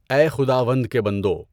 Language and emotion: Urdu, neutral